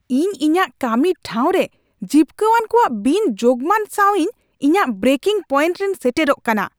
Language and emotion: Santali, angry